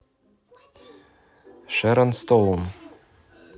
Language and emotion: Russian, neutral